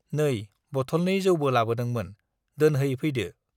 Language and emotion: Bodo, neutral